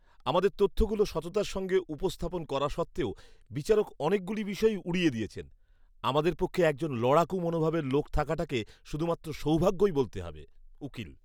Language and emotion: Bengali, disgusted